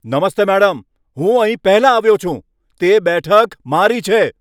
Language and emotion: Gujarati, angry